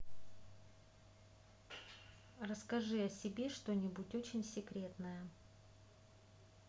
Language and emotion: Russian, neutral